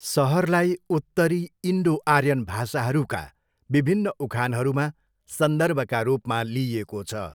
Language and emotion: Nepali, neutral